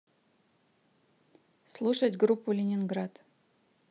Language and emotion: Russian, neutral